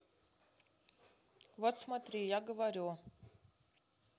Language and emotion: Russian, neutral